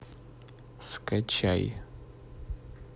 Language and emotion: Russian, neutral